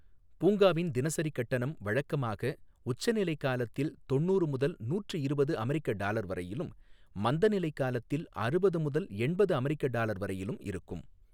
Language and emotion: Tamil, neutral